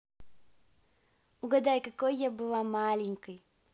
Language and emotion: Russian, positive